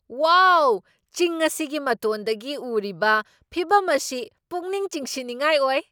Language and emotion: Manipuri, surprised